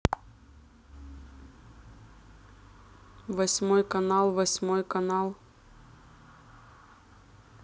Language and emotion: Russian, neutral